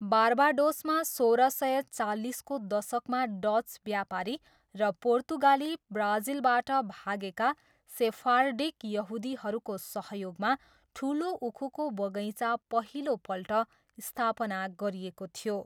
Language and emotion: Nepali, neutral